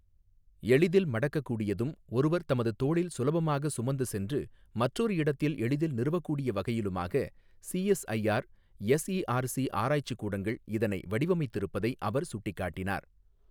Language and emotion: Tamil, neutral